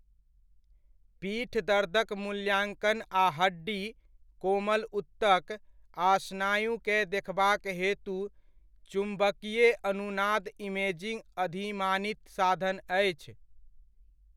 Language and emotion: Maithili, neutral